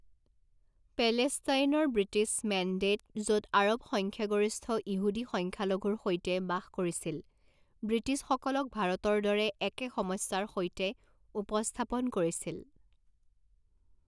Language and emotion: Assamese, neutral